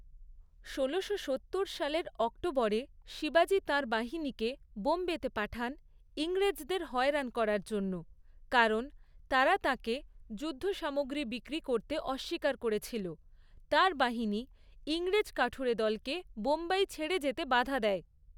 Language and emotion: Bengali, neutral